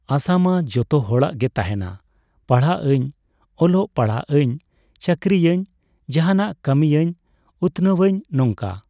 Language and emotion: Santali, neutral